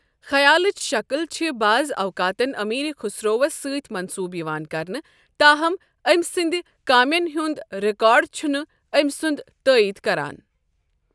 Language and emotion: Kashmiri, neutral